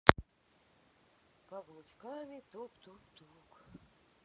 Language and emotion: Russian, sad